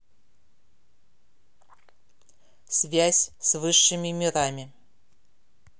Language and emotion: Russian, neutral